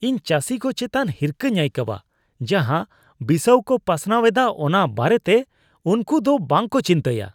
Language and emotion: Santali, disgusted